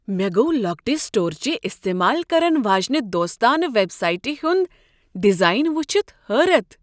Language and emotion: Kashmiri, surprised